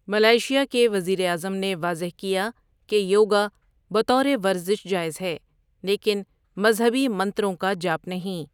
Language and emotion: Urdu, neutral